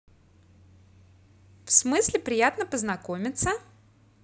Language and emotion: Russian, positive